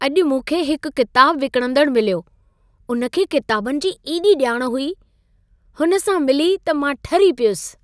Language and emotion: Sindhi, happy